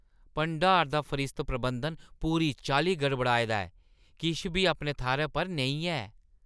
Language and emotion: Dogri, disgusted